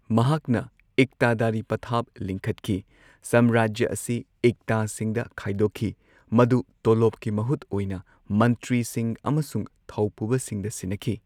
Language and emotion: Manipuri, neutral